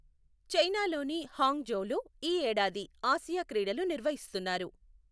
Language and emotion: Telugu, neutral